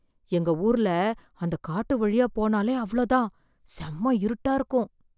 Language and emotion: Tamil, fearful